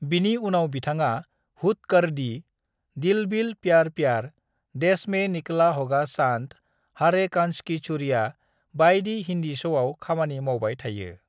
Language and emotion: Bodo, neutral